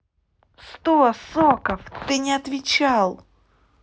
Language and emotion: Russian, angry